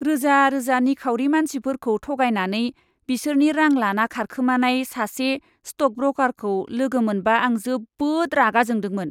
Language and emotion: Bodo, disgusted